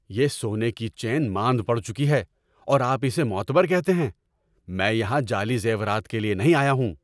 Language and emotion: Urdu, angry